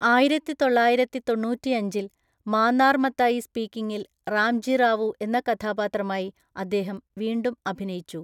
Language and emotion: Malayalam, neutral